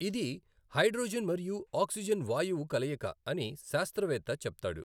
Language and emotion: Telugu, neutral